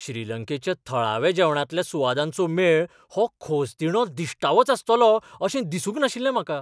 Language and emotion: Goan Konkani, surprised